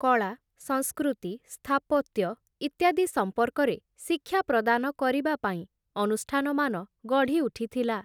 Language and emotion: Odia, neutral